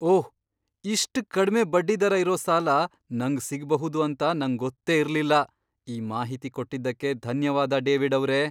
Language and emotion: Kannada, surprised